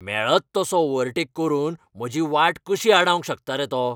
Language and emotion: Goan Konkani, angry